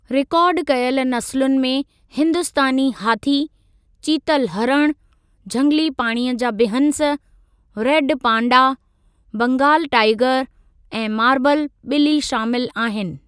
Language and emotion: Sindhi, neutral